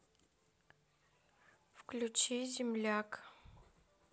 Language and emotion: Russian, neutral